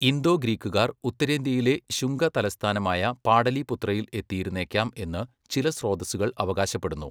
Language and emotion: Malayalam, neutral